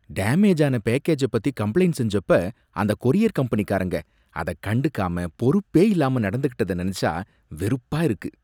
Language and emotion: Tamil, disgusted